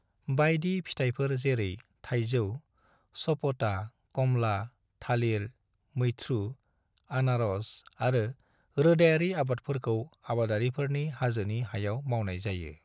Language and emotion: Bodo, neutral